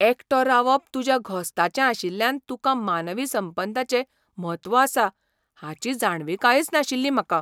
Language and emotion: Goan Konkani, surprised